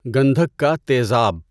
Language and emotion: Urdu, neutral